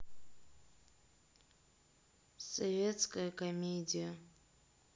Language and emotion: Russian, sad